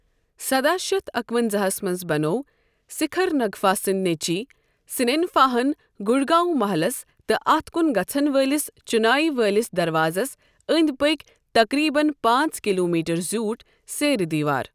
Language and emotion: Kashmiri, neutral